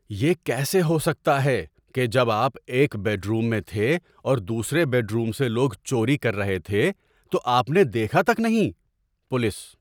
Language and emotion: Urdu, surprised